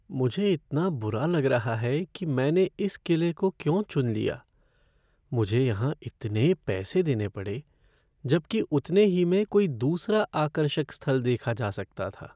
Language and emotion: Hindi, sad